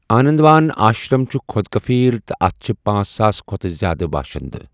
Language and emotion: Kashmiri, neutral